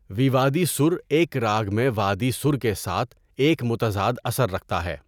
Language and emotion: Urdu, neutral